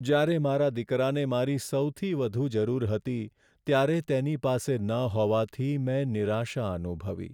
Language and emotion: Gujarati, sad